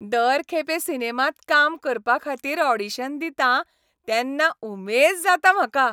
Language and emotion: Goan Konkani, happy